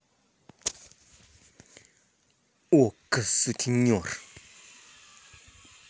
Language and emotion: Russian, angry